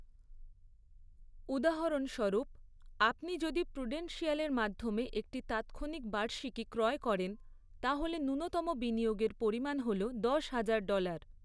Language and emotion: Bengali, neutral